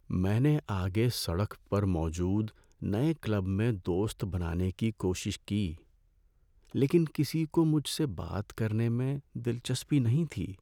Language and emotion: Urdu, sad